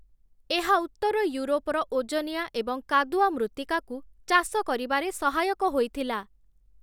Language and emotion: Odia, neutral